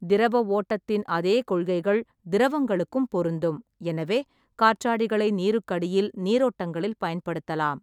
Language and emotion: Tamil, neutral